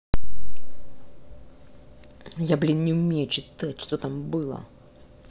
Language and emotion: Russian, angry